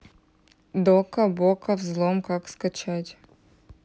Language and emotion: Russian, neutral